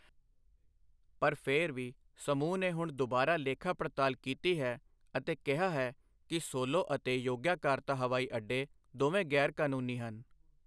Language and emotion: Punjabi, neutral